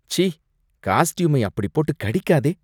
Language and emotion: Tamil, disgusted